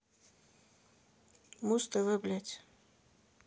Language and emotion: Russian, angry